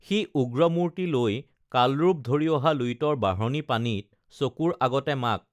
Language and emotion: Assamese, neutral